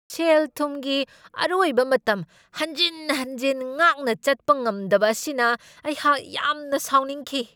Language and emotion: Manipuri, angry